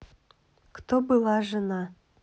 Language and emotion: Russian, neutral